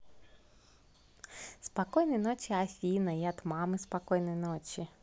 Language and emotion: Russian, positive